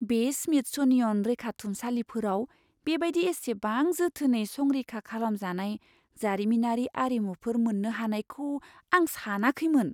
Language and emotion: Bodo, surprised